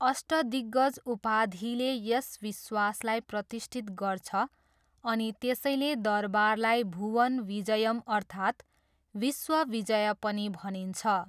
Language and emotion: Nepali, neutral